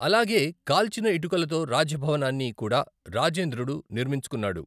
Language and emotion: Telugu, neutral